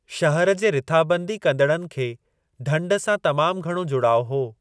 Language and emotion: Sindhi, neutral